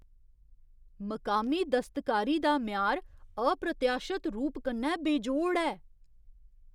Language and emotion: Dogri, surprised